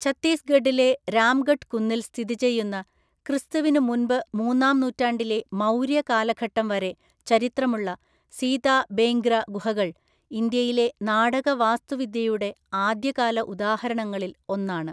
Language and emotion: Malayalam, neutral